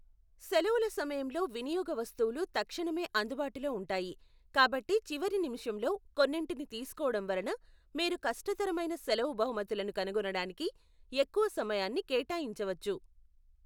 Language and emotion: Telugu, neutral